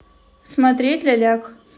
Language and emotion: Russian, neutral